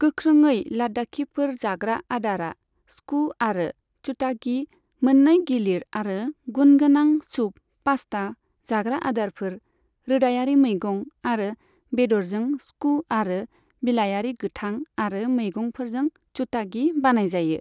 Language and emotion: Bodo, neutral